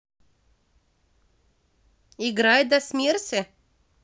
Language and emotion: Russian, positive